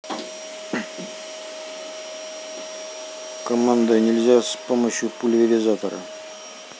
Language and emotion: Russian, neutral